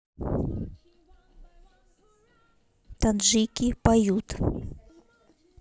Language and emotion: Russian, neutral